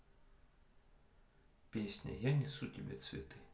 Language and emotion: Russian, neutral